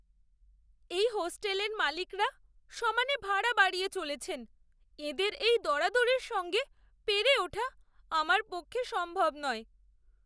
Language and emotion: Bengali, sad